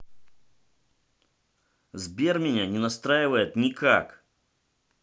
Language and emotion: Russian, angry